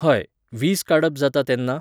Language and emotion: Goan Konkani, neutral